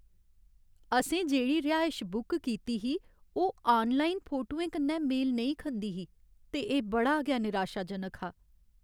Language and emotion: Dogri, sad